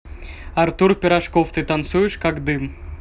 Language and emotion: Russian, neutral